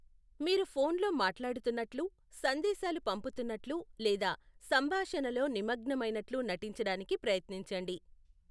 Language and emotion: Telugu, neutral